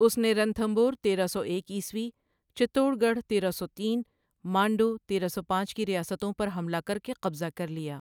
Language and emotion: Urdu, neutral